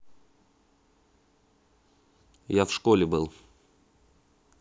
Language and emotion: Russian, neutral